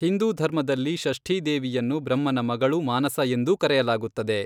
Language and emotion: Kannada, neutral